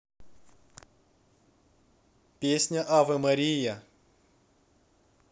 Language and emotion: Russian, neutral